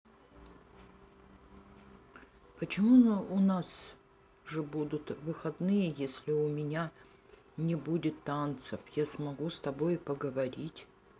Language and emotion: Russian, sad